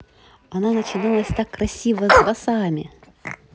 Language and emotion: Russian, positive